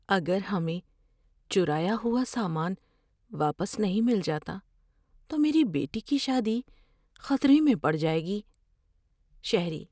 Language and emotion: Urdu, fearful